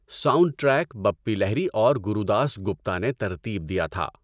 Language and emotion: Urdu, neutral